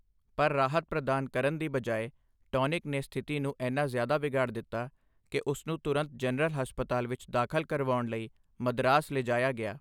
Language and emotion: Punjabi, neutral